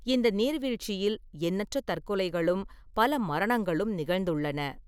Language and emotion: Tamil, neutral